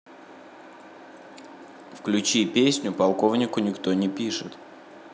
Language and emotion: Russian, neutral